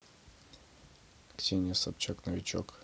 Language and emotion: Russian, neutral